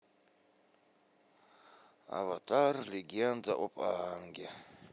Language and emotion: Russian, sad